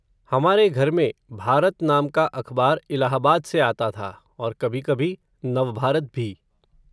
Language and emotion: Hindi, neutral